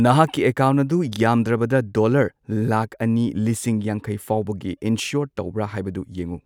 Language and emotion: Manipuri, neutral